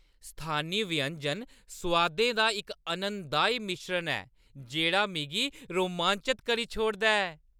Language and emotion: Dogri, happy